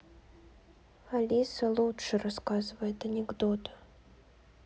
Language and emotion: Russian, sad